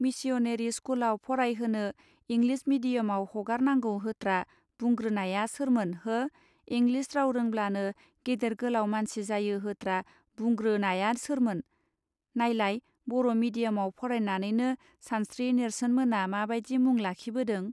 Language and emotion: Bodo, neutral